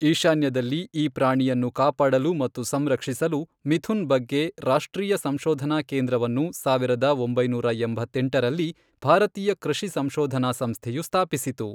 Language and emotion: Kannada, neutral